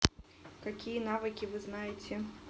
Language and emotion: Russian, neutral